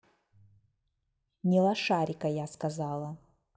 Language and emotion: Russian, angry